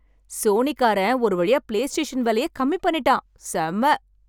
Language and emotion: Tamil, happy